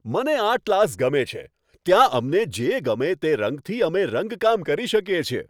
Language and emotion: Gujarati, happy